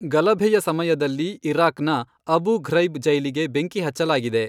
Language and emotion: Kannada, neutral